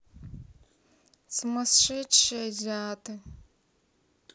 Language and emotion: Russian, neutral